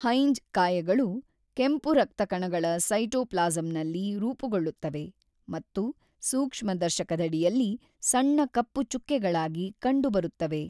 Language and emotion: Kannada, neutral